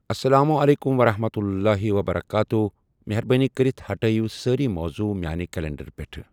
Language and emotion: Kashmiri, neutral